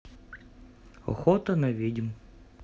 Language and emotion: Russian, neutral